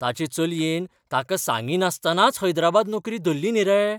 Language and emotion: Goan Konkani, surprised